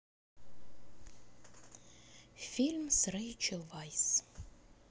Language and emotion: Russian, neutral